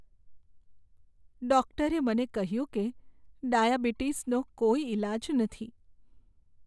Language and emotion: Gujarati, sad